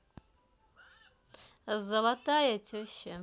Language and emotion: Russian, positive